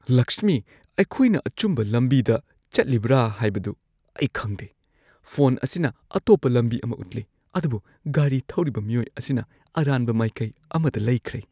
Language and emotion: Manipuri, fearful